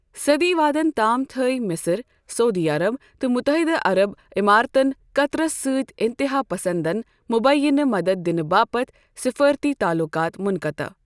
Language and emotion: Kashmiri, neutral